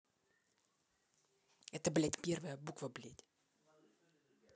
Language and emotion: Russian, angry